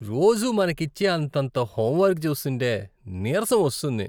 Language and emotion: Telugu, disgusted